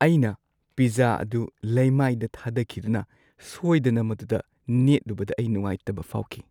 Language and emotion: Manipuri, sad